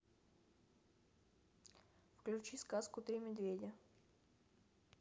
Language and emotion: Russian, neutral